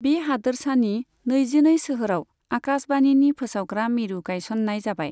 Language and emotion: Bodo, neutral